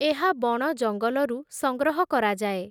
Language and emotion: Odia, neutral